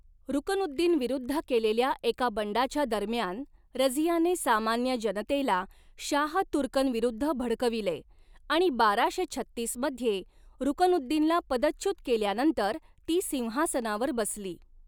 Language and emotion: Marathi, neutral